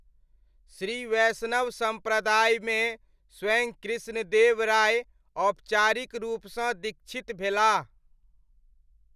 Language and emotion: Maithili, neutral